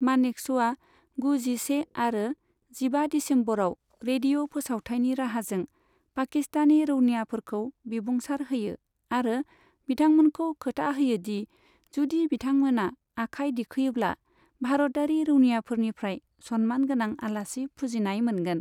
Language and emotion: Bodo, neutral